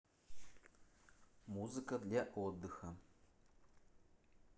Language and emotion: Russian, neutral